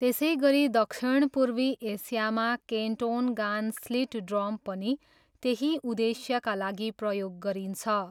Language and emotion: Nepali, neutral